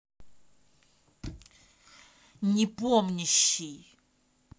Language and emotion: Russian, angry